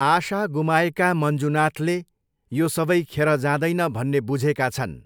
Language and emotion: Nepali, neutral